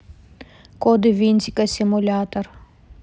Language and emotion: Russian, neutral